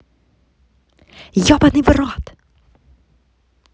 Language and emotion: Russian, angry